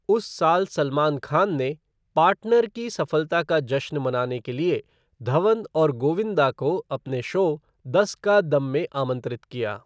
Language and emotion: Hindi, neutral